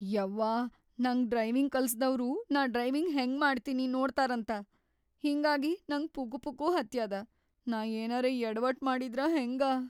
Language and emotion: Kannada, fearful